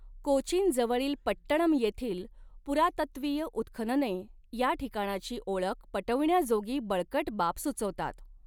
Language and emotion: Marathi, neutral